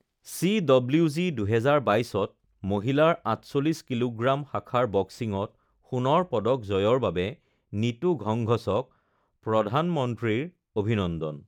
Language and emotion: Assamese, neutral